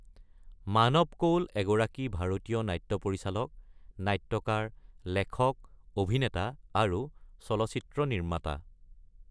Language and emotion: Assamese, neutral